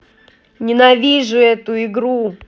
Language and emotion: Russian, angry